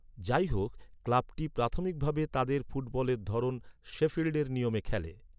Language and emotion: Bengali, neutral